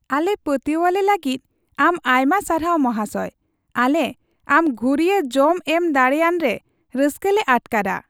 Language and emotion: Santali, happy